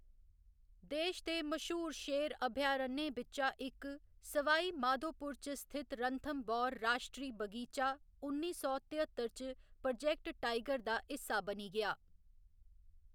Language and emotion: Dogri, neutral